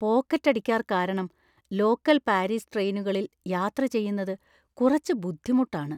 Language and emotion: Malayalam, fearful